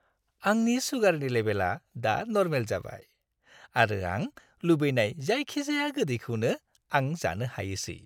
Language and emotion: Bodo, happy